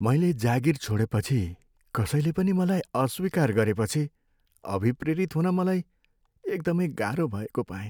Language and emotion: Nepali, sad